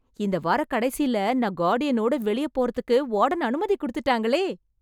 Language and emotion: Tamil, happy